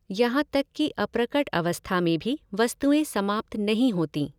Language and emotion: Hindi, neutral